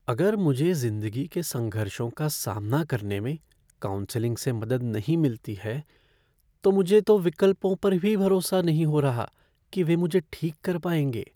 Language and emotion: Hindi, fearful